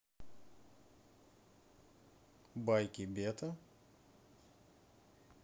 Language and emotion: Russian, neutral